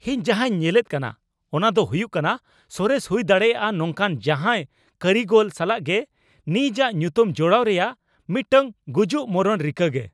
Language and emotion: Santali, angry